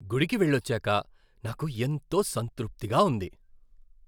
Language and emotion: Telugu, happy